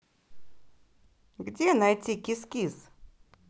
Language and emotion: Russian, positive